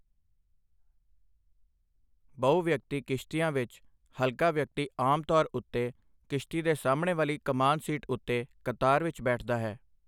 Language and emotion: Punjabi, neutral